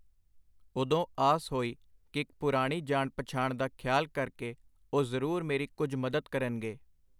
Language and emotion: Punjabi, neutral